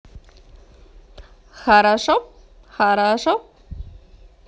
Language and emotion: Russian, positive